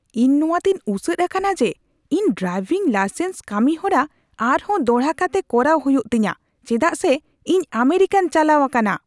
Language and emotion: Santali, angry